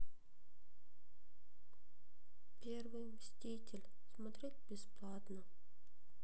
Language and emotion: Russian, sad